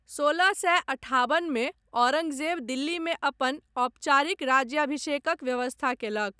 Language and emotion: Maithili, neutral